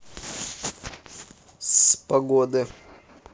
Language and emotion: Russian, neutral